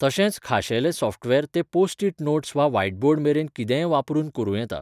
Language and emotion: Goan Konkani, neutral